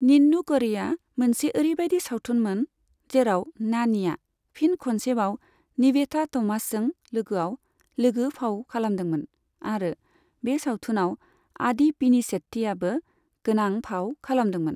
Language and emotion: Bodo, neutral